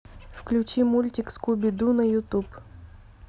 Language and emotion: Russian, neutral